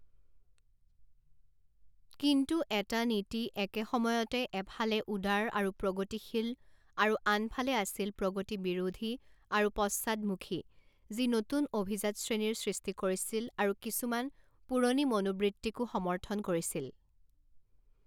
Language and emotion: Assamese, neutral